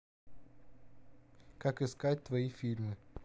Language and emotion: Russian, neutral